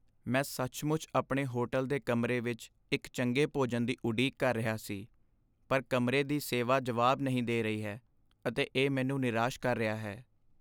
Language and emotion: Punjabi, sad